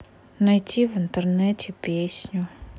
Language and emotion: Russian, sad